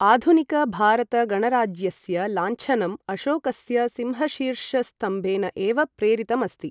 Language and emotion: Sanskrit, neutral